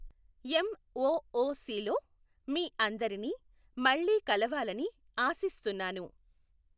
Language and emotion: Telugu, neutral